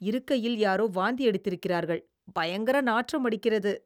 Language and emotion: Tamil, disgusted